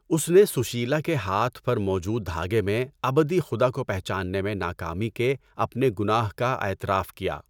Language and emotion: Urdu, neutral